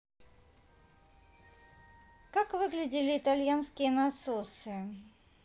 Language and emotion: Russian, neutral